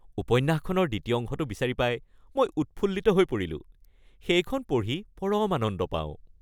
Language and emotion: Assamese, happy